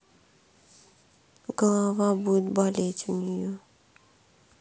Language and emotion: Russian, sad